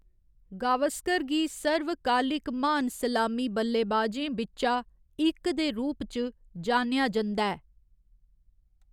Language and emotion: Dogri, neutral